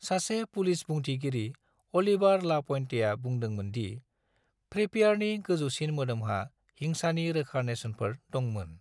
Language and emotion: Bodo, neutral